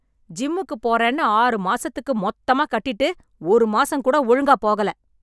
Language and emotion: Tamil, angry